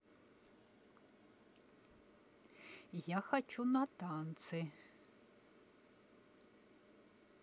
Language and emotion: Russian, neutral